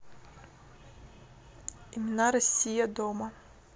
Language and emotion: Russian, neutral